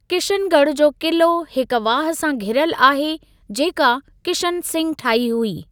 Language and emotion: Sindhi, neutral